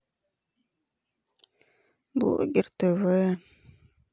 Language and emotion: Russian, sad